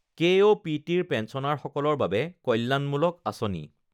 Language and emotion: Assamese, neutral